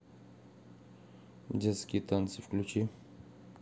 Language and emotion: Russian, neutral